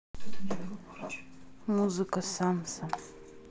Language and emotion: Russian, neutral